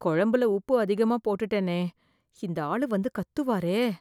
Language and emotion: Tamil, fearful